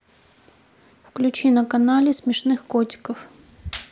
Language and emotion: Russian, neutral